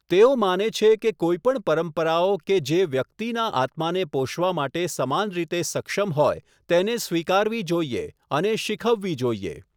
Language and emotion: Gujarati, neutral